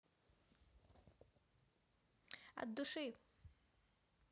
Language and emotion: Russian, positive